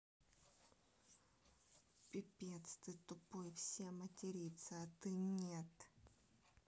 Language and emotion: Russian, angry